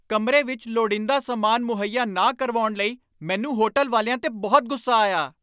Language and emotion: Punjabi, angry